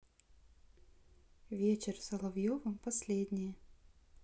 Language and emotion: Russian, neutral